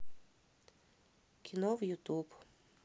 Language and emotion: Russian, neutral